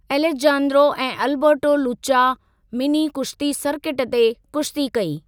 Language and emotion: Sindhi, neutral